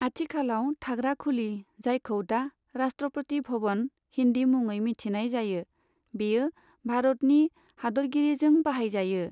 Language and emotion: Bodo, neutral